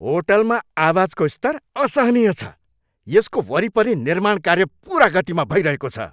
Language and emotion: Nepali, angry